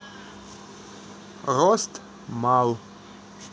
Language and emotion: Russian, neutral